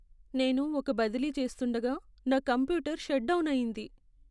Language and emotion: Telugu, sad